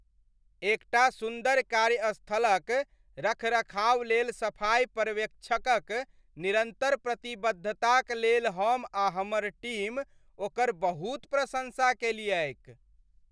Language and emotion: Maithili, happy